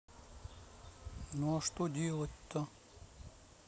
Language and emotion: Russian, neutral